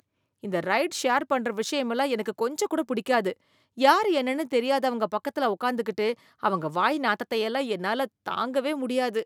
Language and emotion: Tamil, disgusted